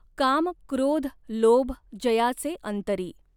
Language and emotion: Marathi, neutral